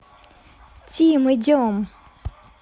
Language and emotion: Russian, neutral